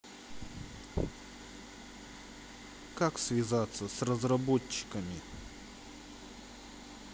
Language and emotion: Russian, neutral